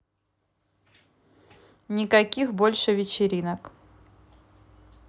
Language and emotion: Russian, neutral